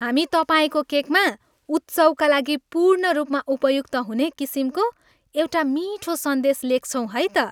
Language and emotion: Nepali, happy